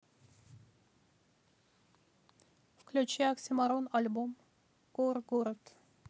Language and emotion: Russian, neutral